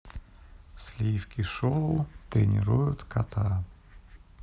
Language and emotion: Russian, neutral